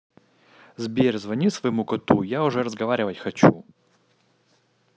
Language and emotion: Russian, angry